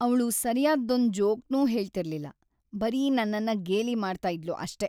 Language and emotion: Kannada, sad